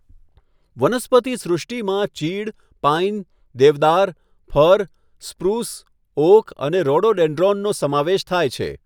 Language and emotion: Gujarati, neutral